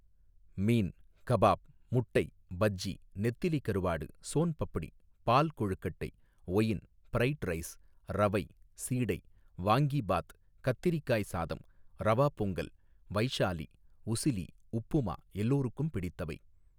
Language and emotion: Tamil, neutral